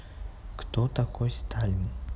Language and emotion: Russian, neutral